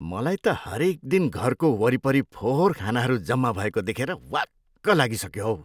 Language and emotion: Nepali, disgusted